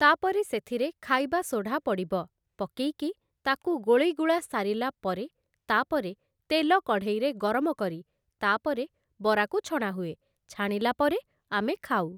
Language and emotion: Odia, neutral